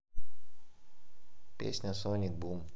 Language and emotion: Russian, neutral